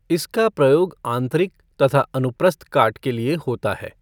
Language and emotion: Hindi, neutral